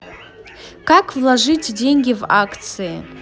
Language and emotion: Russian, neutral